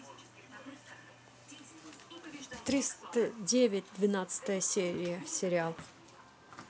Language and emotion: Russian, neutral